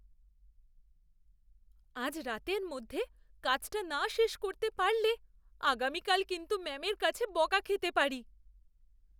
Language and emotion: Bengali, fearful